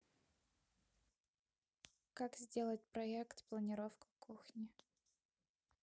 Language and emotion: Russian, neutral